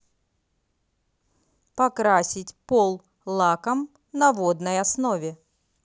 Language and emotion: Russian, neutral